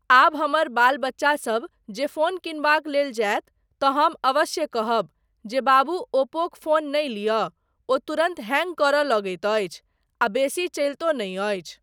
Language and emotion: Maithili, neutral